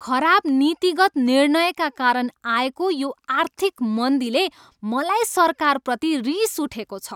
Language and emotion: Nepali, angry